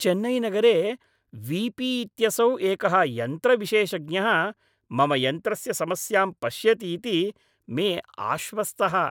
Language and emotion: Sanskrit, happy